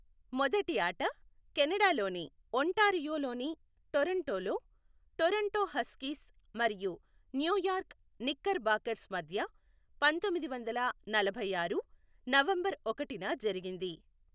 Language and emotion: Telugu, neutral